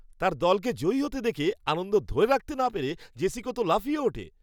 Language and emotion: Bengali, happy